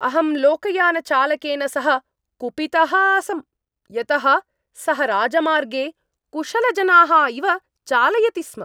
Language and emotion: Sanskrit, angry